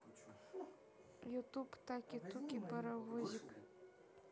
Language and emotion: Russian, neutral